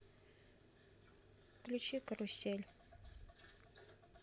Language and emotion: Russian, neutral